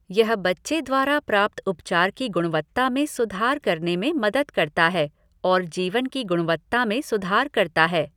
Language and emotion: Hindi, neutral